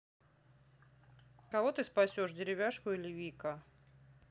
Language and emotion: Russian, neutral